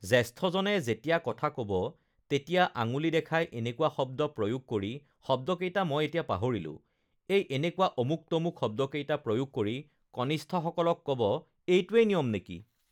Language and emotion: Assamese, neutral